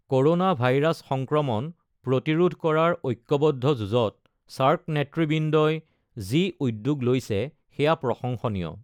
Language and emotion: Assamese, neutral